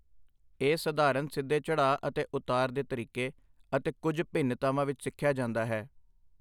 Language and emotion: Punjabi, neutral